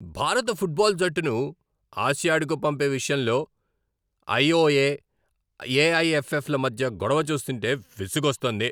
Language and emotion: Telugu, angry